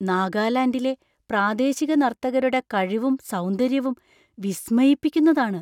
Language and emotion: Malayalam, surprised